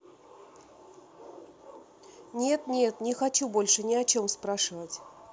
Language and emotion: Russian, sad